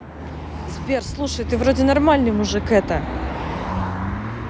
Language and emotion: Russian, neutral